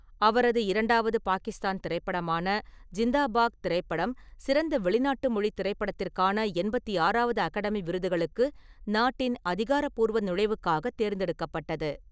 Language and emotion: Tamil, neutral